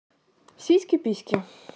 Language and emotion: Russian, neutral